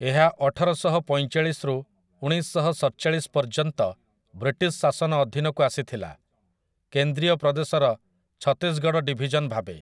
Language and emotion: Odia, neutral